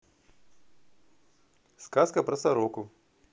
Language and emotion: Russian, positive